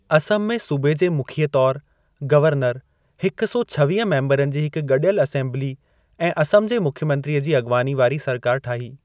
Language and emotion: Sindhi, neutral